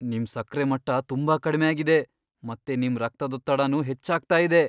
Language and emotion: Kannada, fearful